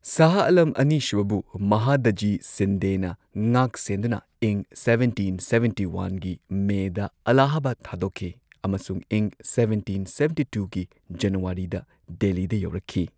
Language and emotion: Manipuri, neutral